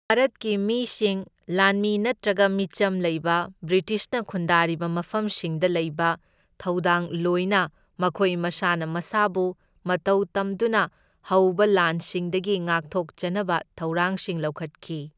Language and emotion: Manipuri, neutral